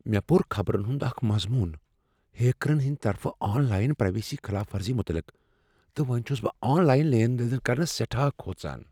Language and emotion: Kashmiri, fearful